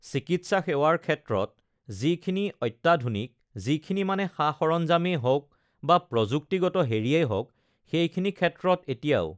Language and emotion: Assamese, neutral